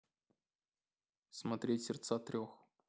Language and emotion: Russian, neutral